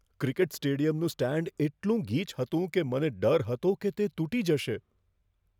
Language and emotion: Gujarati, fearful